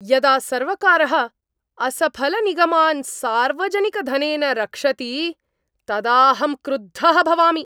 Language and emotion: Sanskrit, angry